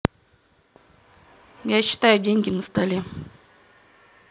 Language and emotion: Russian, neutral